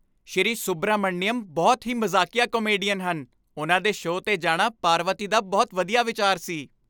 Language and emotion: Punjabi, happy